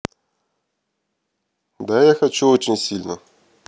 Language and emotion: Russian, neutral